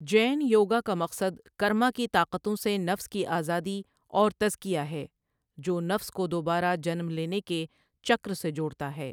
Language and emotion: Urdu, neutral